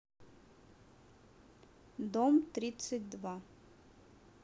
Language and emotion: Russian, neutral